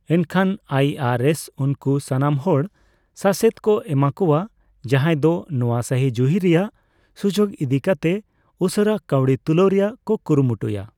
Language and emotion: Santali, neutral